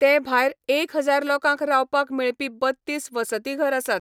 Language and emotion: Goan Konkani, neutral